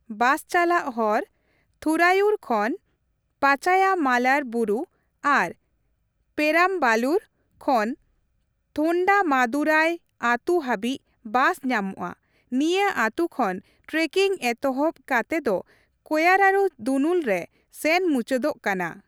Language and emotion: Santali, neutral